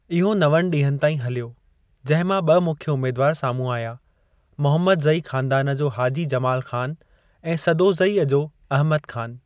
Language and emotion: Sindhi, neutral